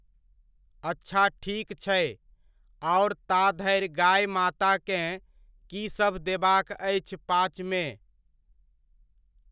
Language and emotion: Maithili, neutral